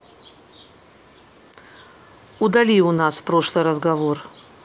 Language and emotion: Russian, neutral